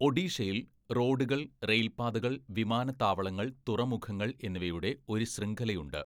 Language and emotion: Malayalam, neutral